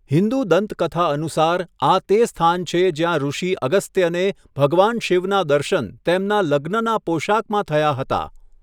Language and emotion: Gujarati, neutral